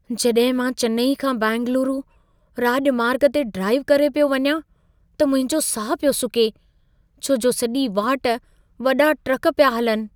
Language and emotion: Sindhi, fearful